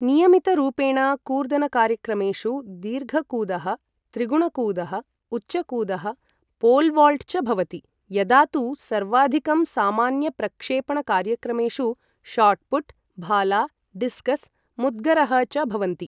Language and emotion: Sanskrit, neutral